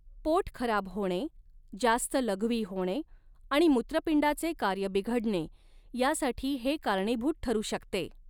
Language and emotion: Marathi, neutral